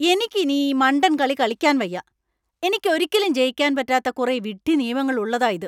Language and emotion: Malayalam, angry